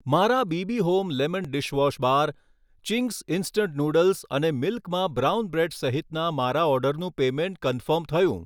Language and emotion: Gujarati, neutral